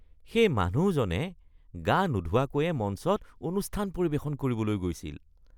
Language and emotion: Assamese, disgusted